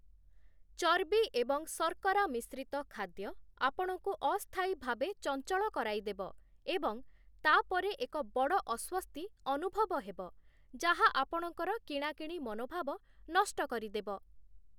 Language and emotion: Odia, neutral